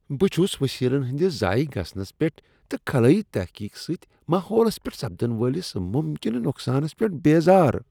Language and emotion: Kashmiri, disgusted